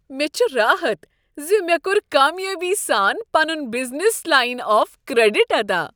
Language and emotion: Kashmiri, happy